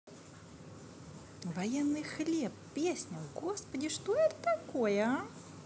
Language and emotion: Russian, positive